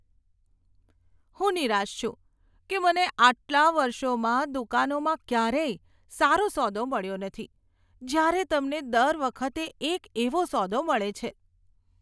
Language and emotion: Gujarati, disgusted